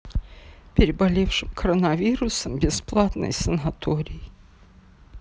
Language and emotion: Russian, sad